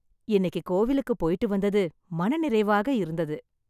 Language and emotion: Tamil, happy